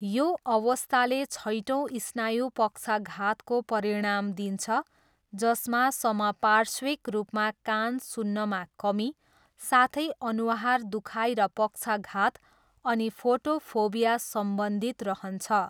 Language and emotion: Nepali, neutral